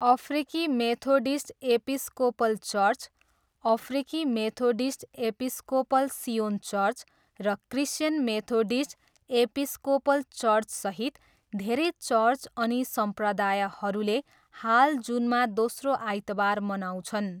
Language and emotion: Nepali, neutral